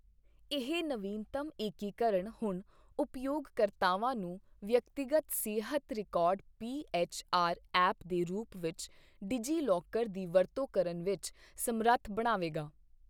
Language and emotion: Punjabi, neutral